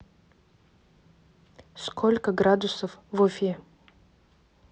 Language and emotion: Russian, neutral